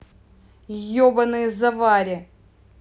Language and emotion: Russian, angry